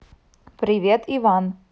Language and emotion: Russian, neutral